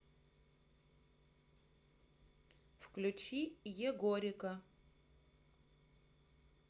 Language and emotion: Russian, neutral